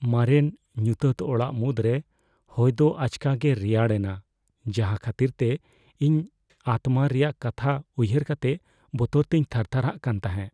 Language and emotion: Santali, fearful